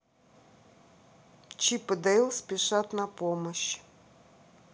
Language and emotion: Russian, neutral